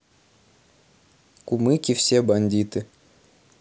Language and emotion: Russian, neutral